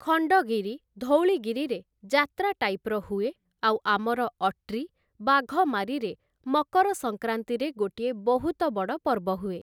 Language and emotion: Odia, neutral